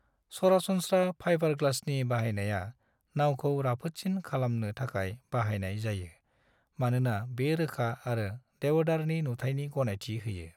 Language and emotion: Bodo, neutral